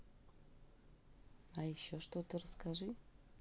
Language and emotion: Russian, neutral